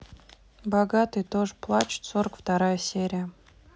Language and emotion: Russian, neutral